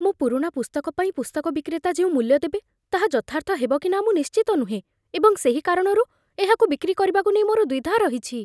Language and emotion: Odia, fearful